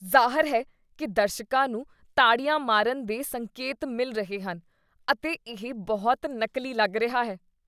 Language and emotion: Punjabi, disgusted